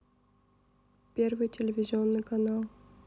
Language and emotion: Russian, neutral